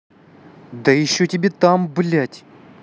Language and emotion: Russian, angry